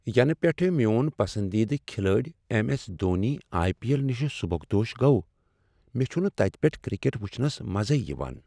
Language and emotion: Kashmiri, sad